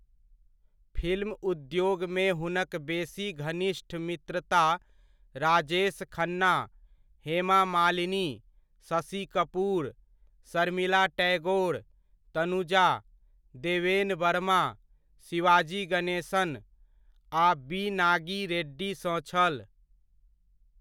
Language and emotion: Maithili, neutral